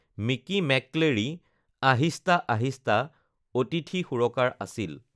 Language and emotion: Assamese, neutral